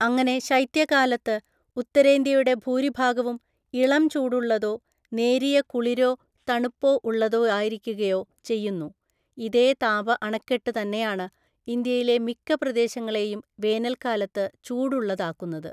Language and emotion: Malayalam, neutral